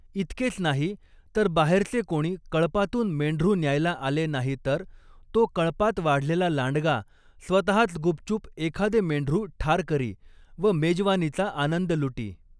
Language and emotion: Marathi, neutral